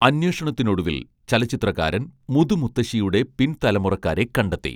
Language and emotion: Malayalam, neutral